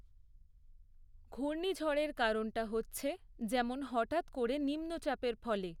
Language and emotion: Bengali, neutral